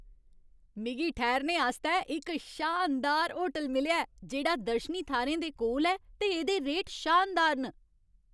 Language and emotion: Dogri, happy